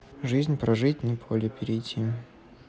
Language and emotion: Russian, neutral